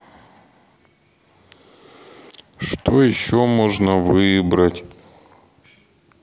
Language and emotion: Russian, sad